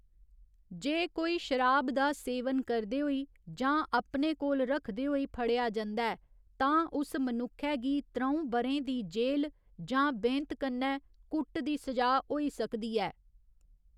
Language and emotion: Dogri, neutral